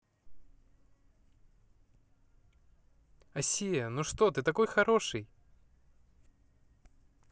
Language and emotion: Russian, positive